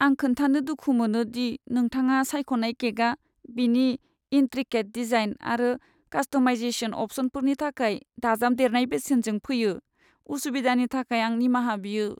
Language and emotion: Bodo, sad